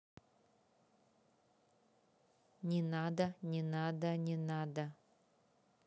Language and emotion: Russian, neutral